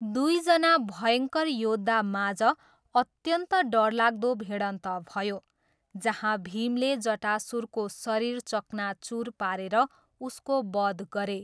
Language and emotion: Nepali, neutral